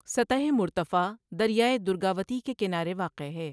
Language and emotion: Urdu, neutral